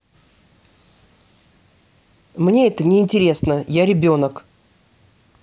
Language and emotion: Russian, angry